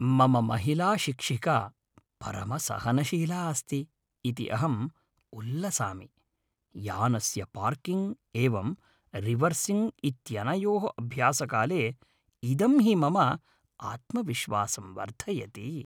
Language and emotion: Sanskrit, happy